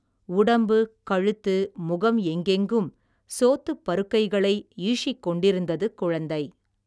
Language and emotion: Tamil, neutral